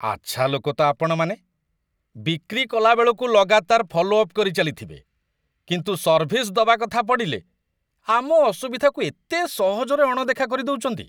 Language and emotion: Odia, disgusted